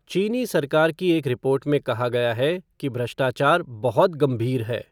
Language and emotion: Hindi, neutral